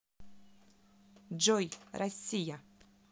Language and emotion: Russian, neutral